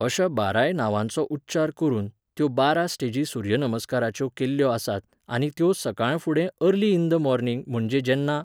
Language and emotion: Goan Konkani, neutral